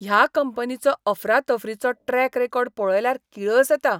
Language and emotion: Goan Konkani, disgusted